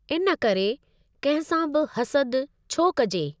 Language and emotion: Sindhi, neutral